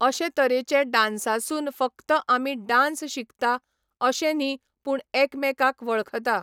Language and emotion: Goan Konkani, neutral